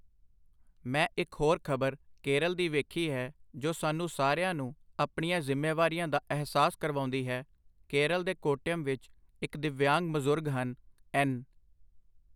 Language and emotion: Punjabi, neutral